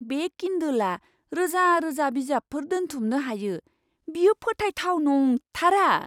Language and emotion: Bodo, surprised